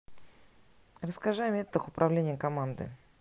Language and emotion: Russian, neutral